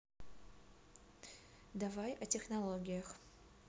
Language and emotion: Russian, neutral